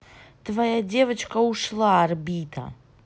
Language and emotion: Russian, neutral